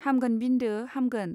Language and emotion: Bodo, neutral